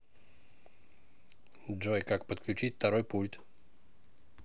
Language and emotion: Russian, neutral